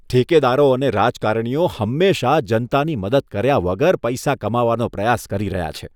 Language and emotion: Gujarati, disgusted